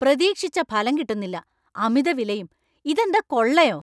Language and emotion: Malayalam, angry